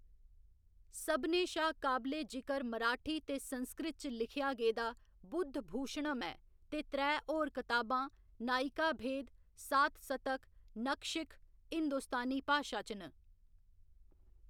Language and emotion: Dogri, neutral